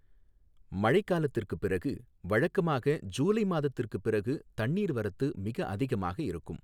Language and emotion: Tamil, neutral